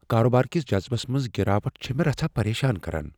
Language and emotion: Kashmiri, fearful